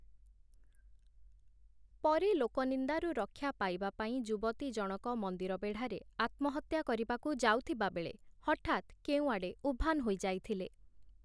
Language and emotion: Odia, neutral